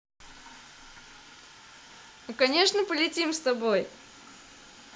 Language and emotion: Russian, positive